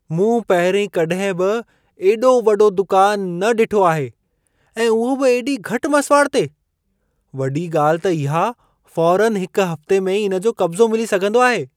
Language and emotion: Sindhi, surprised